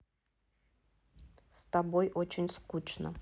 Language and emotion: Russian, neutral